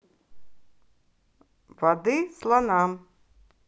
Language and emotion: Russian, neutral